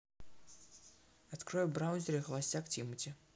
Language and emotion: Russian, neutral